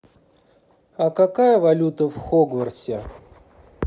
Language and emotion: Russian, neutral